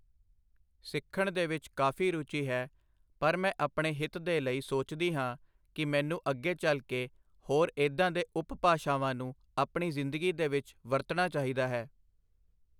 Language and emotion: Punjabi, neutral